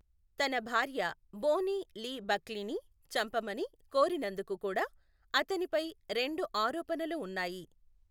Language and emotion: Telugu, neutral